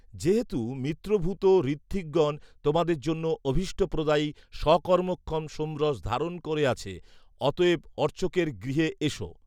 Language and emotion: Bengali, neutral